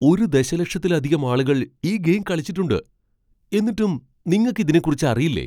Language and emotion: Malayalam, surprised